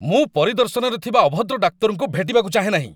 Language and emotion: Odia, angry